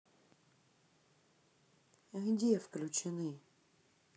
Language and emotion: Russian, angry